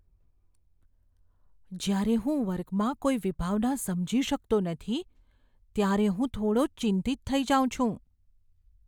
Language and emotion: Gujarati, fearful